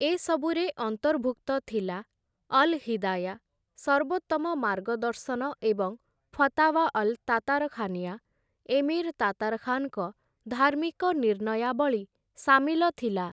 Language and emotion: Odia, neutral